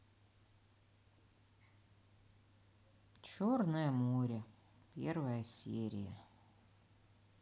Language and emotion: Russian, sad